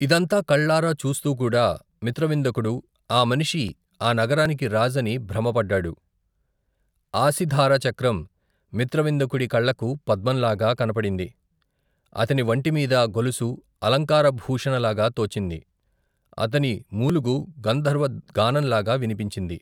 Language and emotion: Telugu, neutral